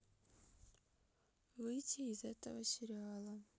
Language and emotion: Russian, sad